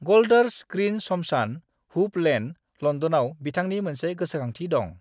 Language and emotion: Bodo, neutral